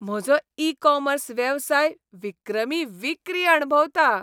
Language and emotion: Goan Konkani, happy